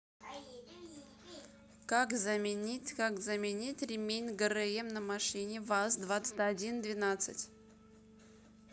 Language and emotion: Russian, neutral